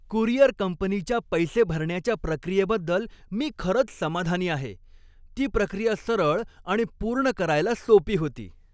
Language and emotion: Marathi, happy